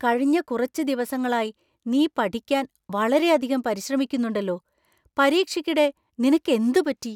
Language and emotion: Malayalam, surprised